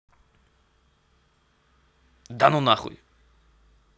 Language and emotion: Russian, angry